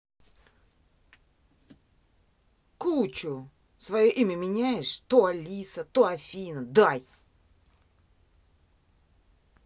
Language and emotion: Russian, angry